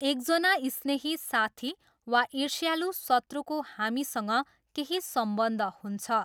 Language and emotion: Nepali, neutral